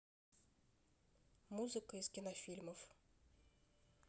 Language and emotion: Russian, neutral